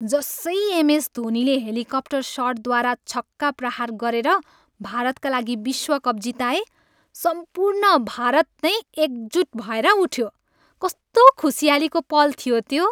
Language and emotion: Nepali, happy